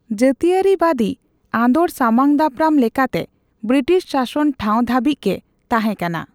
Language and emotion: Santali, neutral